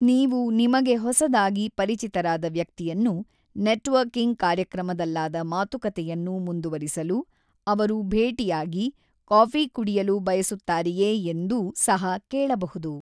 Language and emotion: Kannada, neutral